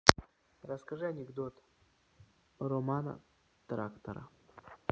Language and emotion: Russian, neutral